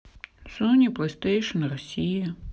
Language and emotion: Russian, sad